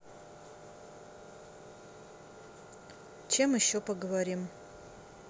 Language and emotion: Russian, neutral